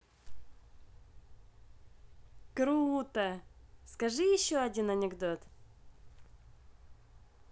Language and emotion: Russian, positive